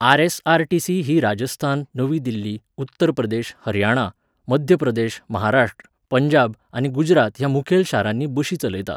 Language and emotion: Goan Konkani, neutral